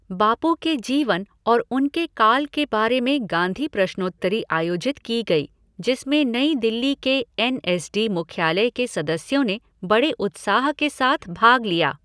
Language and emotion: Hindi, neutral